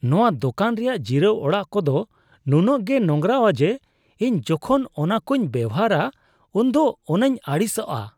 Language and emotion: Santali, disgusted